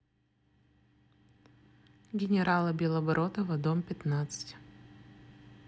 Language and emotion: Russian, neutral